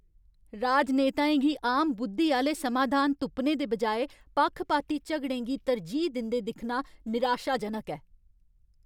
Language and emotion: Dogri, angry